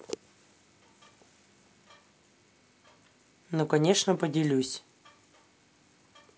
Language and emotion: Russian, neutral